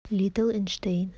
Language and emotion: Russian, neutral